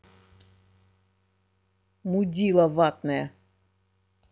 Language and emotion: Russian, angry